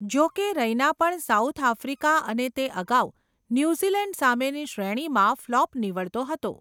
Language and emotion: Gujarati, neutral